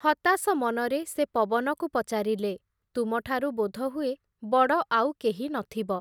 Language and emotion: Odia, neutral